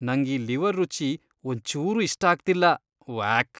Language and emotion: Kannada, disgusted